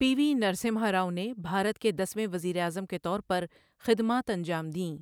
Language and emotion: Urdu, neutral